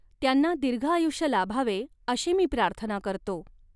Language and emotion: Marathi, neutral